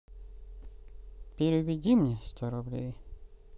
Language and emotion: Russian, sad